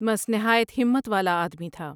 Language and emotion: Urdu, neutral